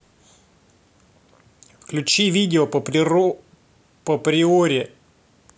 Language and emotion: Russian, neutral